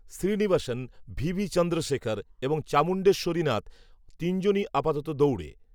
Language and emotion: Bengali, neutral